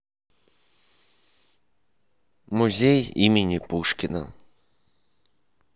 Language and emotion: Russian, neutral